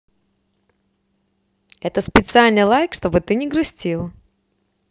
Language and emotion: Russian, positive